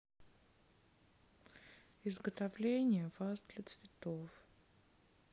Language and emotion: Russian, sad